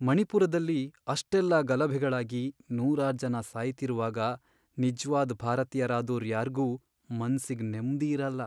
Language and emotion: Kannada, sad